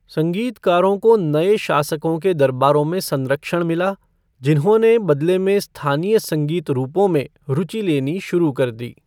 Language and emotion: Hindi, neutral